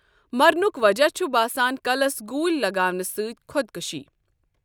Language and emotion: Kashmiri, neutral